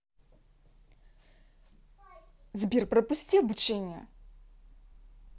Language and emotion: Russian, angry